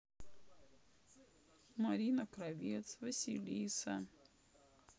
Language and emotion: Russian, sad